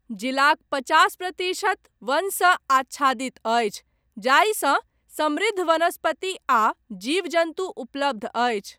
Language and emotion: Maithili, neutral